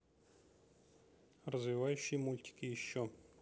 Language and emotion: Russian, neutral